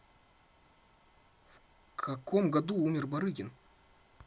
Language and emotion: Russian, neutral